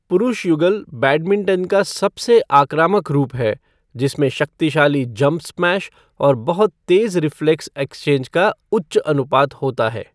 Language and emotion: Hindi, neutral